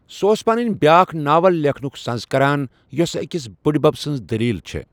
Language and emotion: Kashmiri, neutral